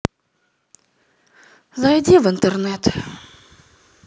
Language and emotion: Russian, sad